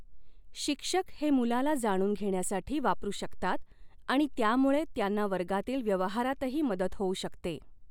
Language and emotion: Marathi, neutral